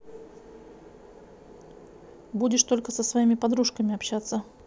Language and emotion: Russian, neutral